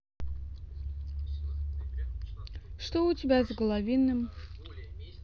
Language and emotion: Russian, neutral